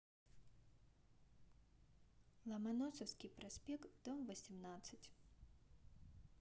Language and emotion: Russian, neutral